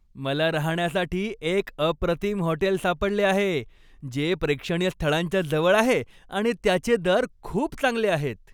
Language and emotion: Marathi, happy